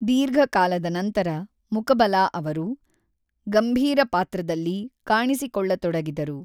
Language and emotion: Kannada, neutral